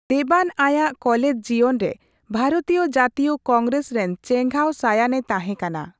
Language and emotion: Santali, neutral